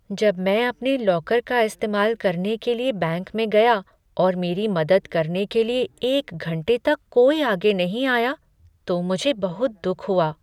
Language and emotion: Hindi, sad